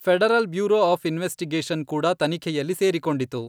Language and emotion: Kannada, neutral